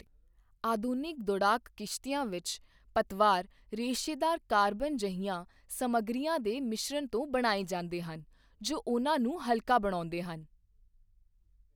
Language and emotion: Punjabi, neutral